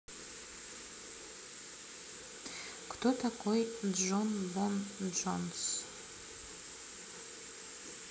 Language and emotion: Russian, neutral